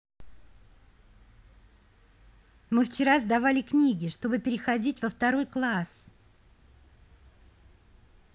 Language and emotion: Russian, positive